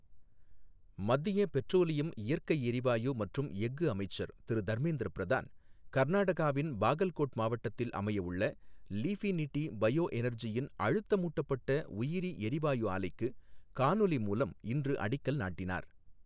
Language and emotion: Tamil, neutral